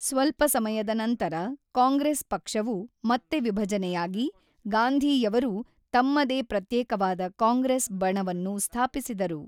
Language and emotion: Kannada, neutral